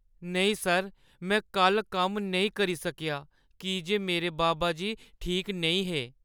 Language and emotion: Dogri, sad